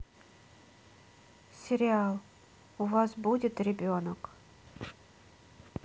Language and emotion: Russian, neutral